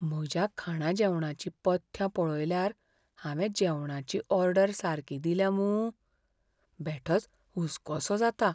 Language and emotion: Goan Konkani, fearful